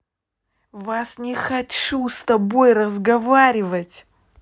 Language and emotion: Russian, angry